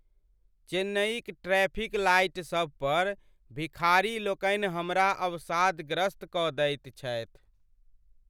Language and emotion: Maithili, sad